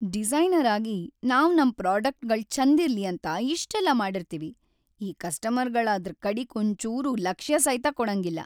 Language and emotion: Kannada, sad